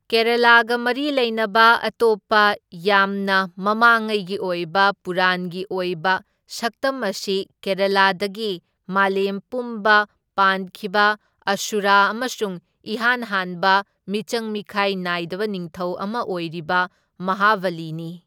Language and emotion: Manipuri, neutral